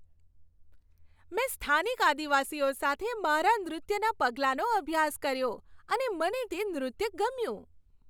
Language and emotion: Gujarati, happy